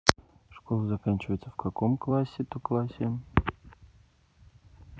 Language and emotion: Russian, neutral